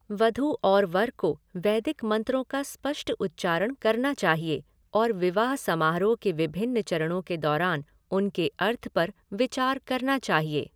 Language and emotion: Hindi, neutral